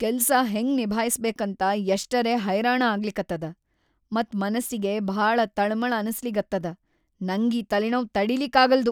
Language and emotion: Kannada, angry